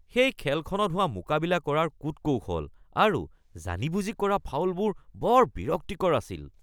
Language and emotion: Assamese, disgusted